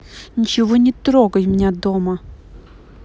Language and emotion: Russian, angry